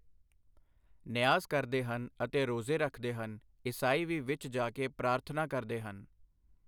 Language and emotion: Punjabi, neutral